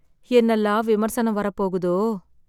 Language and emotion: Tamil, sad